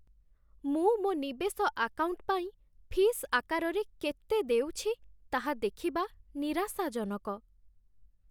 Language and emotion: Odia, sad